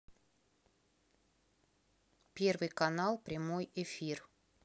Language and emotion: Russian, neutral